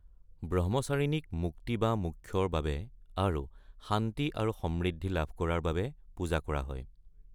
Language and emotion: Assamese, neutral